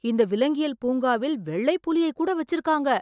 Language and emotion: Tamil, surprised